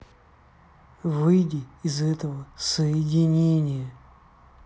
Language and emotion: Russian, angry